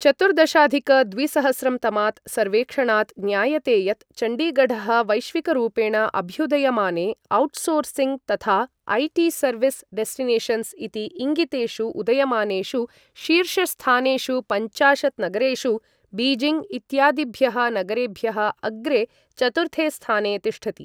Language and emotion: Sanskrit, neutral